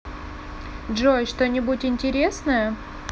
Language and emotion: Russian, neutral